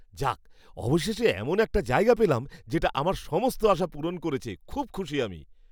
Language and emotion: Bengali, happy